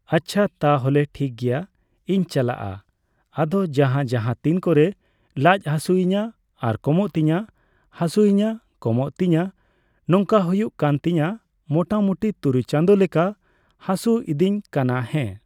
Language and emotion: Santali, neutral